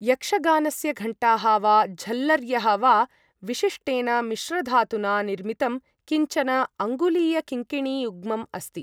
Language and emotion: Sanskrit, neutral